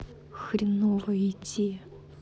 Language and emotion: Russian, sad